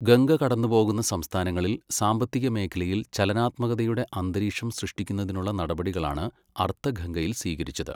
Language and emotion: Malayalam, neutral